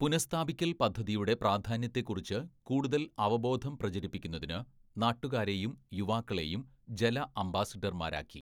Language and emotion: Malayalam, neutral